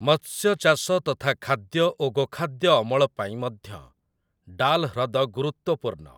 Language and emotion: Odia, neutral